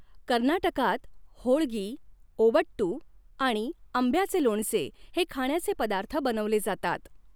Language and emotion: Marathi, neutral